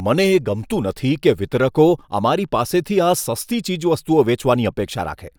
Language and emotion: Gujarati, disgusted